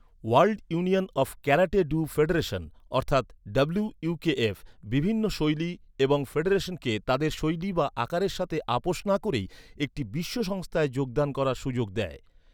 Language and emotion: Bengali, neutral